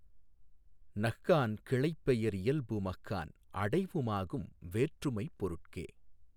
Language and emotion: Tamil, neutral